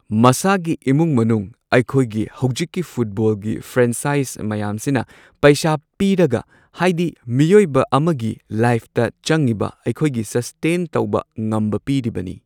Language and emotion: Manipuri, neutral